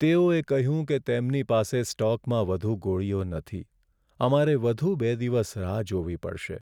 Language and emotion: Gujarati, sad